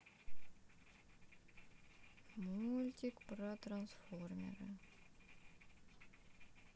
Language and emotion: Russian, sad